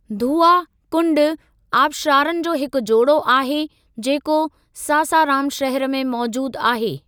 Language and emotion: Sindhi, neutral